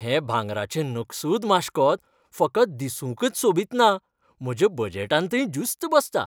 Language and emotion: Goan Konkani, happy